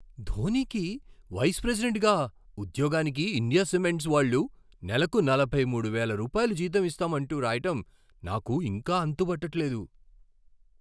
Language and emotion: Telugu, surprised